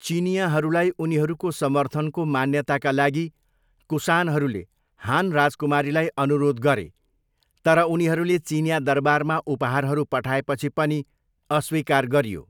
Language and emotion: Nepali, neutral